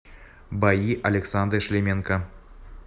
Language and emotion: Russian, neutral